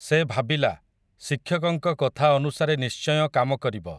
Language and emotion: Odia, neutral